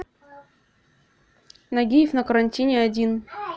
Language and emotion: Russian, neutral